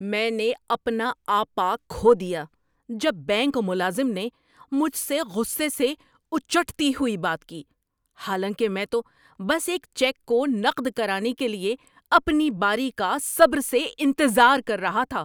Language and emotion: Urdu, angry